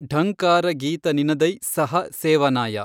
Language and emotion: Kannada, neutral